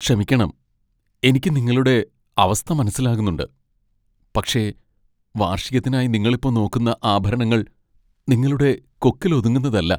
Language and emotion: Malayalam, sad